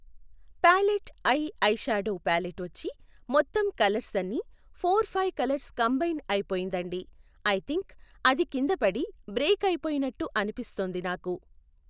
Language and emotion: Telugu, neutral